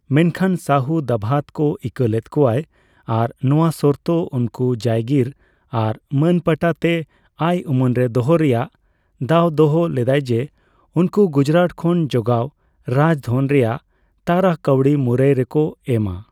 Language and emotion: Santali, neutral